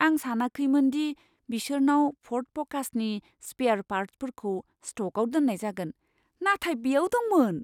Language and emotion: Bodo, surprised